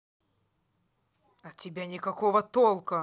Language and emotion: Russian, angry